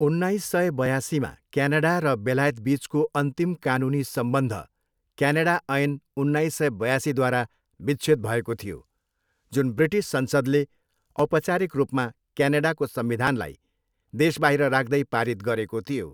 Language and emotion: Nepali, neutral